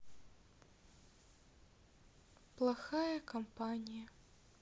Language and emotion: Russian, sad